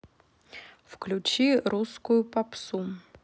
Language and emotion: Russian, neutral